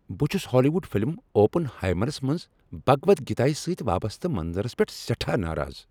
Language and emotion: Kashmiri, angry